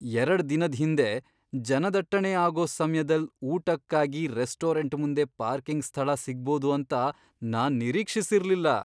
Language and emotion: Kannada, surprised